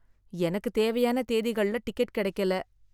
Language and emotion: Tamil, sad